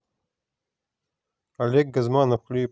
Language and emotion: Russian, neutral